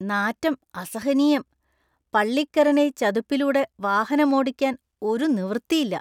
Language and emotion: Malayalam, disgusted